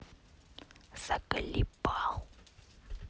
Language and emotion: Russian, angry